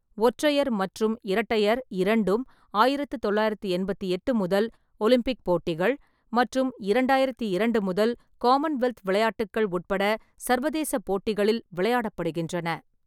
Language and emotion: Tamil, neutral